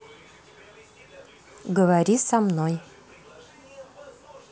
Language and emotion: Russian, positive